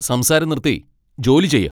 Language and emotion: Malayalam, angry